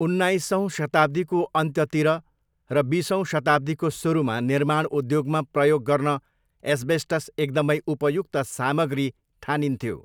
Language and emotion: Nepali, neutral